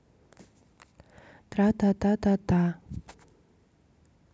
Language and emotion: Russian, neutral